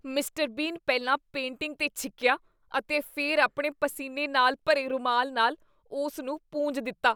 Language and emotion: Punjabi, disgusted